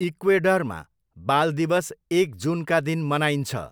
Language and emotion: Nepali, neutral